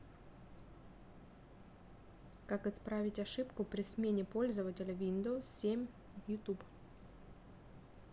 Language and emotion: Russian, neutral